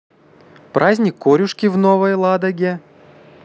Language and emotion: Russian, positive